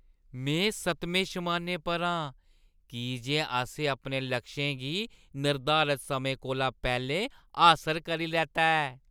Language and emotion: Dogri, happy